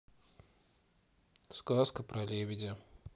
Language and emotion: Russian, neutral